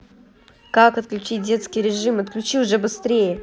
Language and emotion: Russian, angry